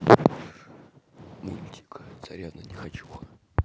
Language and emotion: Russian, neutral